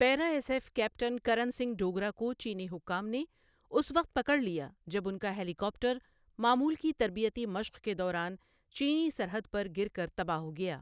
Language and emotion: Urdu, neutral